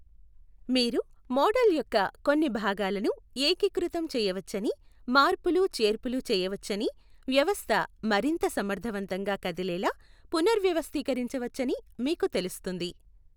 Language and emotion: Telugu, neutral